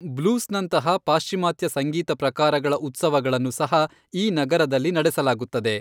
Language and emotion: Kannada, neutral